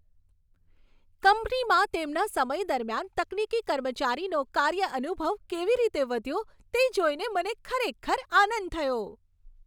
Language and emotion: Gujarati, happy